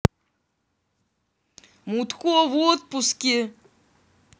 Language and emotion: Russian, angry